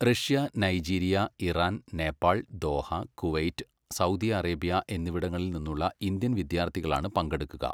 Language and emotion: Malayalam, neutral